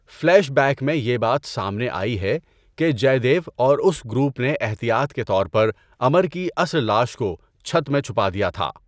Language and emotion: Urdu, neutral